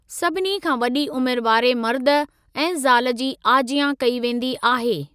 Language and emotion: Sindhi, neutral